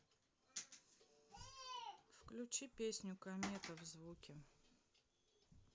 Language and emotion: Russian, neutral